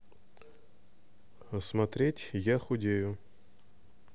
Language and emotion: Russian, neutral